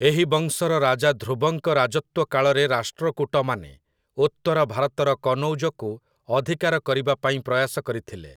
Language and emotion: Odia, neutral